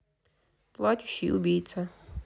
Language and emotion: Russian, neutral